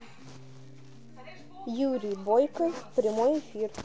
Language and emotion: Russian, neutral